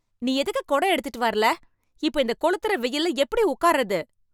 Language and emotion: Tamil, angry